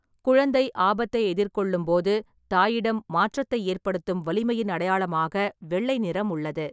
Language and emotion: Tamil, neutral